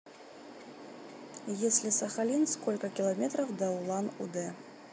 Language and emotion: Russian, neutral